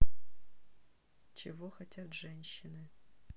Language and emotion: Russian, neutral